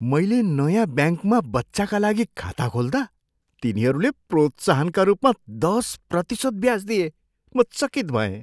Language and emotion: Nepali, surprised